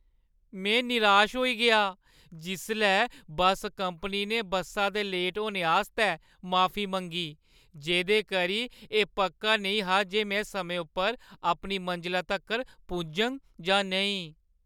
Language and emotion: Dogri, sad